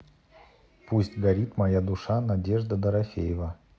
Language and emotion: Russian, neutral